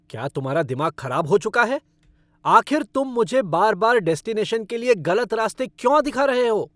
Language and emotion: Hindi, angry